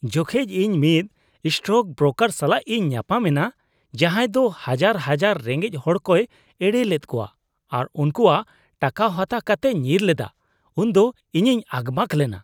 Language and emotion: Santali, disgusted